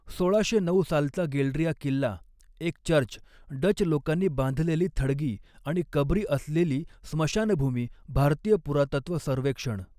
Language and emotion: Marathi, neutral